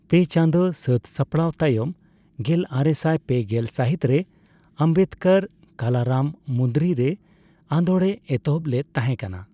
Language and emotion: Santali, neutral